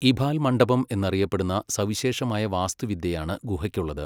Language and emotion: Malayalam, neutral